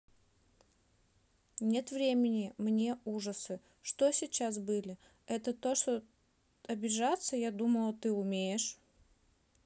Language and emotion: Russian, neutral